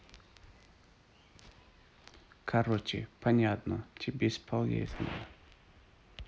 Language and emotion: Russian, neutral